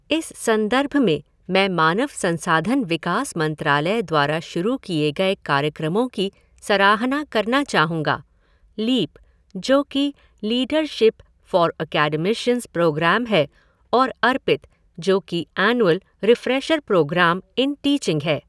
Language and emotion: Hindi, neutral